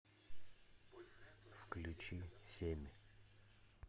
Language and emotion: Russian, neutral